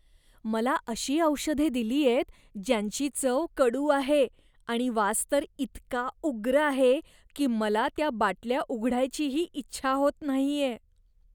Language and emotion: Marathi, disgusted